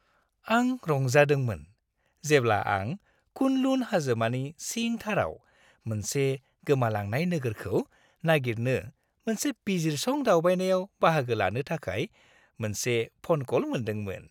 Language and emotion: Bodo, happy